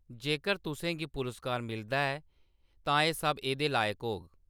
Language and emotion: Dogri, neutral